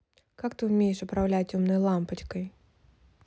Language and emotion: Russian, neutral